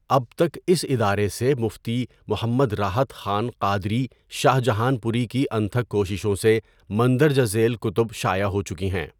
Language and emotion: Urdu, neutral